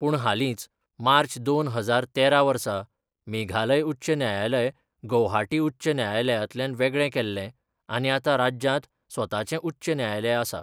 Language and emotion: Goan Konkani, neutral